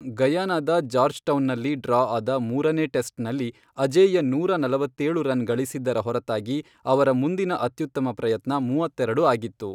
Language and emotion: Kannada, neutral